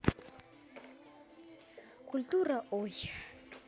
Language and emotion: Russian, neutral